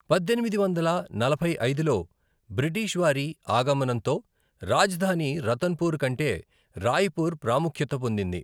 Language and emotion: Telugu, neutral